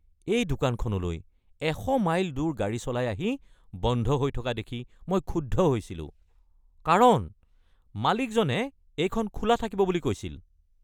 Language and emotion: Assamese, angry